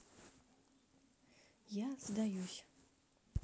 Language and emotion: Russian, neutral